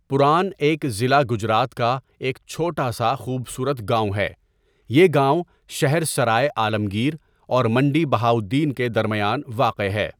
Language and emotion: Urdu, neutral